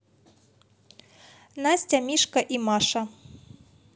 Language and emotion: Russian, positive